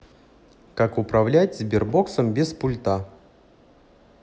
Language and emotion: Russian, neutral